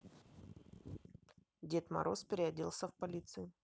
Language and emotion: Russian, neutral